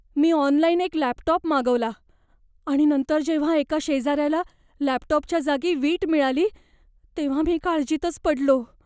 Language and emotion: Marathi, fearful